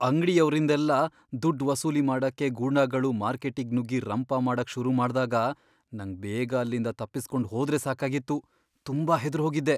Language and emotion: Kannada, fearful